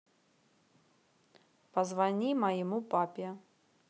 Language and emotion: Russian, neutral